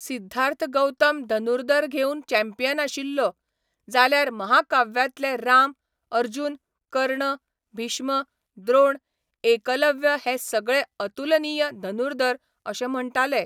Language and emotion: Goan Konkani, neutral